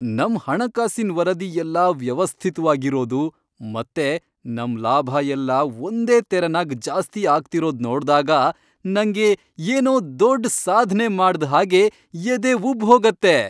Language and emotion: Kannada, happy